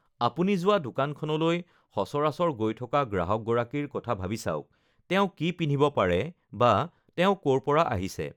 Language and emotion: Assamese, neutral